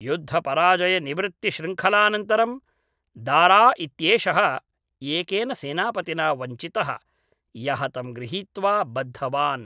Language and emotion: Sanskrit, neutral